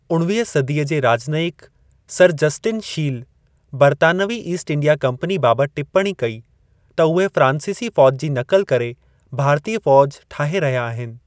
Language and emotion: Sindhi, neutral